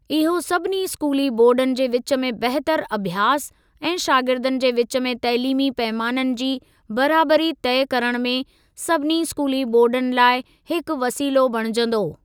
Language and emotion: Sindhi, neutral